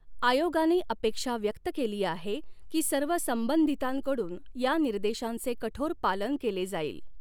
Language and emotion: Marathi, neutral